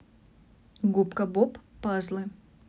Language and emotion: Russian, neutral